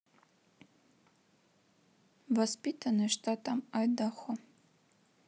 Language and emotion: Russian, neutral